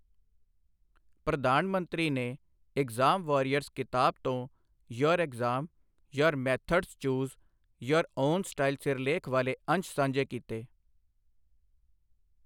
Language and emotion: Punjabi, neutral